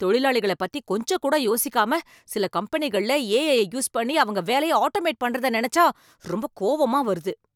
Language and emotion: Tamil, angry